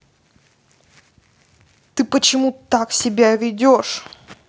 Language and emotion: Russian, angry